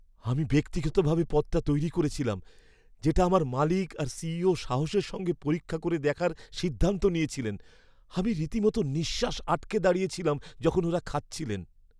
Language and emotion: Bengali, fearful